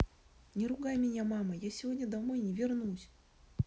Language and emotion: Russian, sad